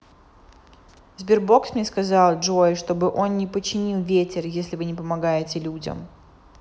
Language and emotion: Russian, neutral